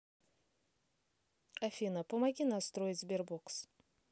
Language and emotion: Russian, neutral